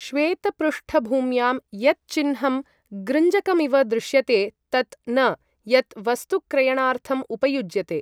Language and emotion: Sanskrit, neutral